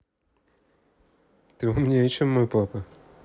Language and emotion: Russian, positive